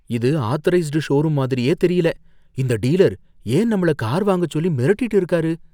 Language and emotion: Tamil, fearful